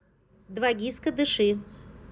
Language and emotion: Russian, neutral